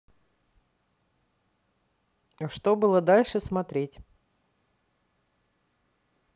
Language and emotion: Russian, neutral